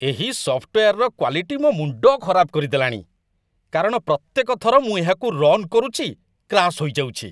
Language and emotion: Odia, disgusted